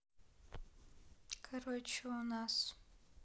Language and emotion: Russian, sad